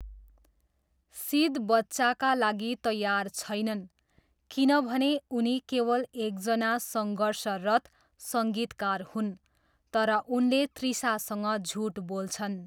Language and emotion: Nepali, neutral